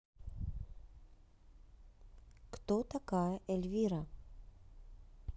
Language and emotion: Russian, neutral